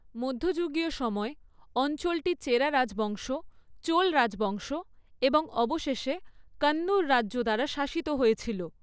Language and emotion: Bengali, neutral